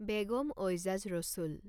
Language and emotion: Assamese, neutral